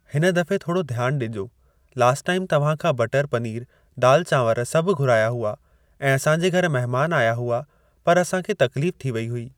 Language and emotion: Sindhi, neutral